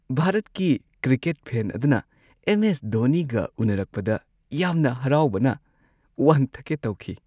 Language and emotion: Manipuri, happy